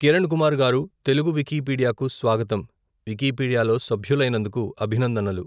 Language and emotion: Telugu, neutral